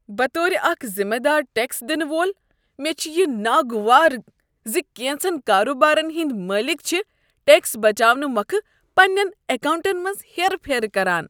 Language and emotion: Kashmiri, disgusted